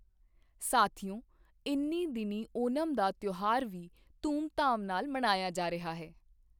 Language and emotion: Punjabi, neutral